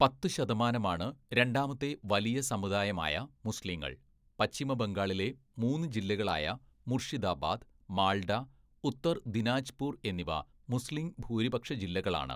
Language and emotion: Malayalam, neutral